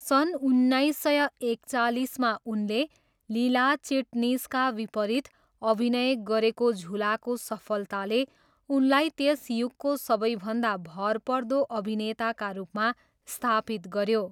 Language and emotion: Nepali, neutral